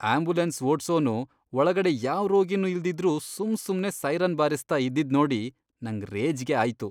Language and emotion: Kannada, disgusted